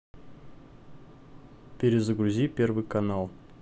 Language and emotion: Russian, neutral